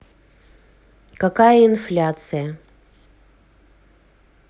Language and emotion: Russian, neutral